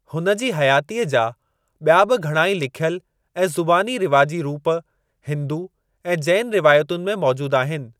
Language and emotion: Sindhi, neutral